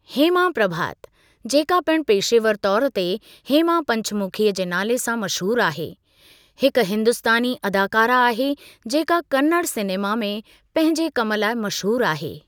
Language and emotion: Sindhi, neutral